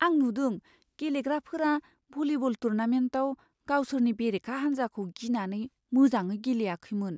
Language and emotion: Bodo, fearful